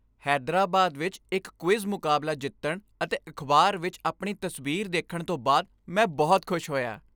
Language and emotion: Punjabi, happy